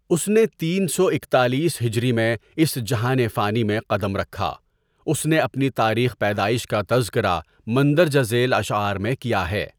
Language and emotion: Urdu, neutral